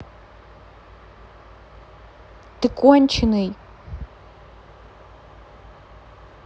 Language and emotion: Russian, angry